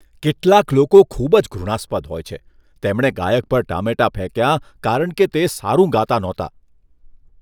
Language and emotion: Gujarati, disgusted